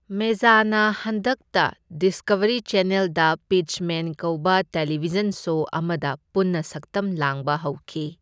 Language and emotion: Manipuri, neutral